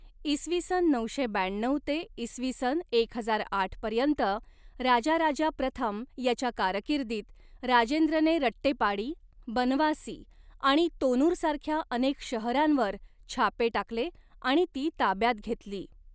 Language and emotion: Marathi, neutral